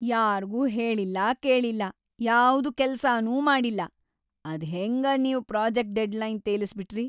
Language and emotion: Kannada, angry